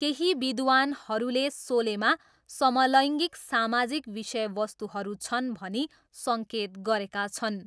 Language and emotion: Nepali, neutral